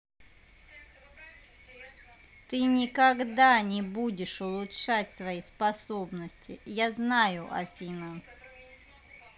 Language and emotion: Russian, angry